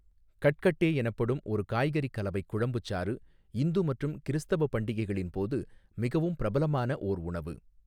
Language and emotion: Tamil, neutral